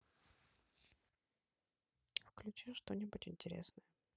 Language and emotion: Russian, neutral